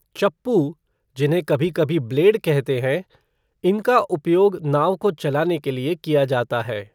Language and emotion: Hindi, neutral